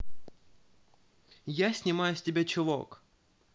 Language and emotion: Russian, positive